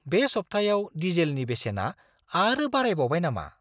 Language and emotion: Bodo, surprised